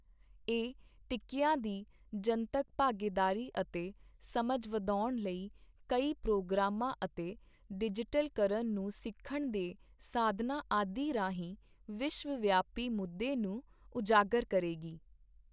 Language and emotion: Punjabi, neutral